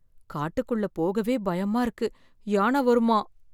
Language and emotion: Tamil, fearful